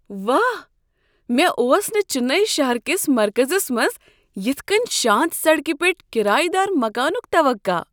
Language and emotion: Kashmiri, surprised